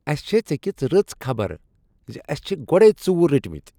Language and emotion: Kashmiri, happy